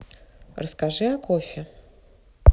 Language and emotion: Russian, neutral